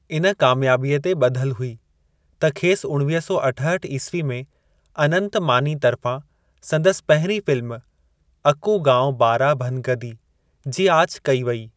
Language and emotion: Sindhi, neutral